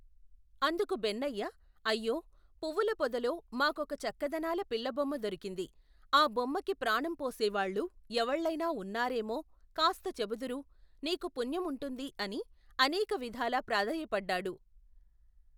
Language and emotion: Telugu, neutral